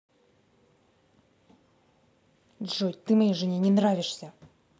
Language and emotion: Russian, angry